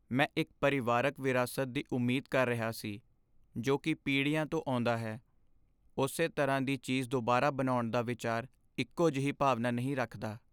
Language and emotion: Punjabi, sad